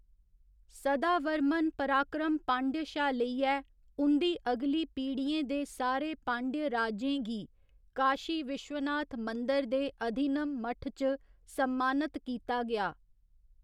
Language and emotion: Dogri, neutral